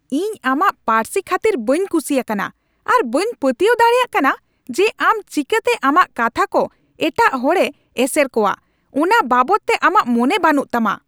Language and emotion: Santali, angry